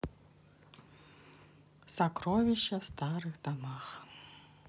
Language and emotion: Russian, neutral